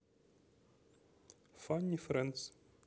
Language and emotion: Russian, neutral